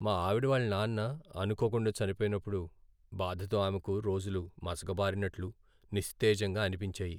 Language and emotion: Telugu, sad